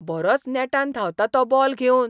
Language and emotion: Goan Konkani, surprised